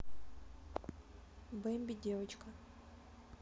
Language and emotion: Russian, neutral